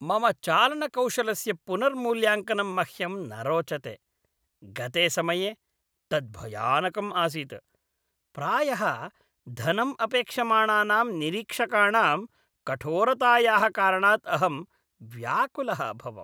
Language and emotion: Sanskrit, disgusted